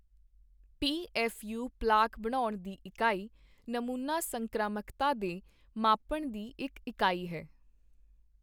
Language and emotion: Punjabi, neutral